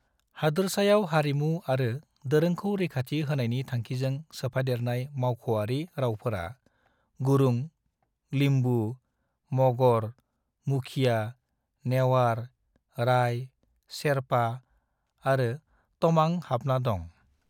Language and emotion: Bodo, neutral